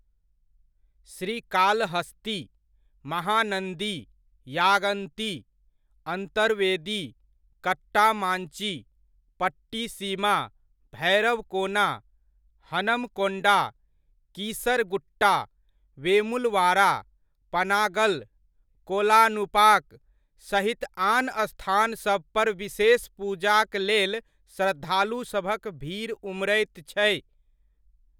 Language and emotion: Maithili, neutral